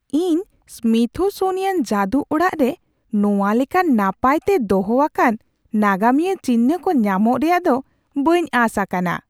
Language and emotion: Santali, surprised